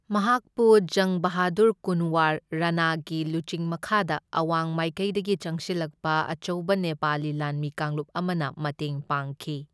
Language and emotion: Manipuri, neutral